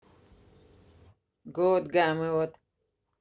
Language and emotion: Russian, neutral